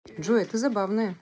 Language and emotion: Russian, positive